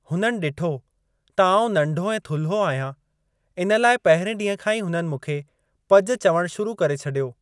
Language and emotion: Sindhi, neutral